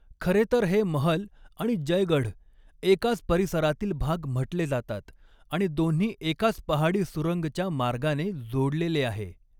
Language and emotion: Marathi, neutral